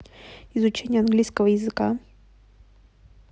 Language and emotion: Russian, neutral